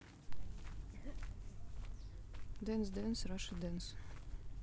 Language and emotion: Russian, neutral